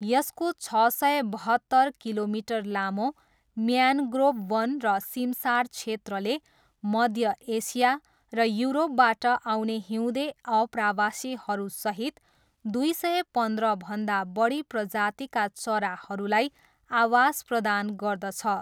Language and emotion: Nepali, neutral